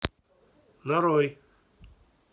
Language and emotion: Russian, neutral